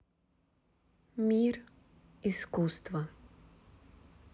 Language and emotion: Russian, neutral